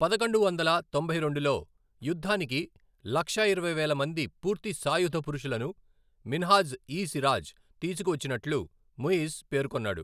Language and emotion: Telugu, neutral